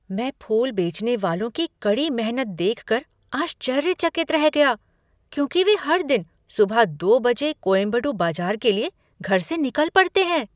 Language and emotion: Hindi, surprised